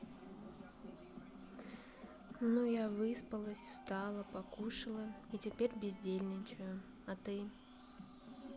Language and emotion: Russian, neutral